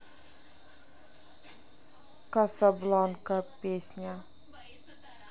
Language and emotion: Russian, neutral